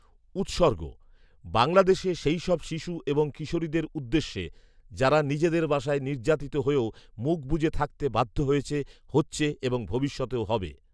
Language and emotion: Bengali, neutral